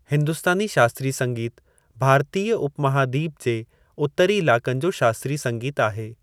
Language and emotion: Sindhi, neutral